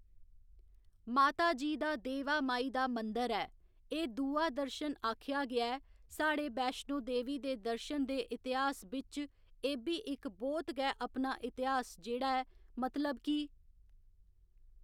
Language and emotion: Dogri, neutral